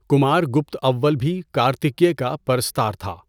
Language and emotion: Urdu, neutral